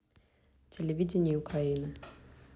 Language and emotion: Russian, neutral